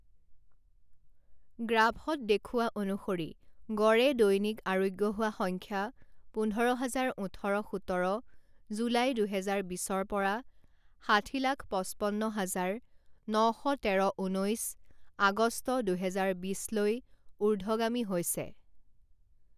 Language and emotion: Assamese, neutral